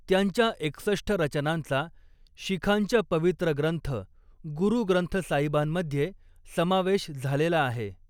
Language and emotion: Marathi, neutral